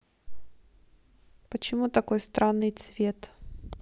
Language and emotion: Russian, neutral